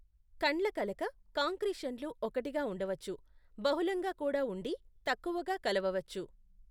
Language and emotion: Telugu, neutral